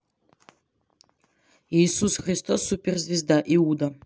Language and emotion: Russian, neutral